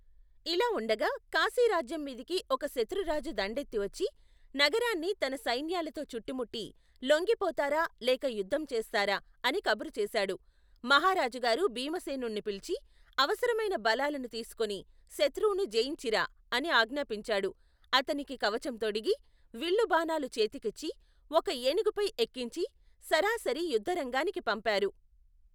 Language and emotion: Telugu, neutral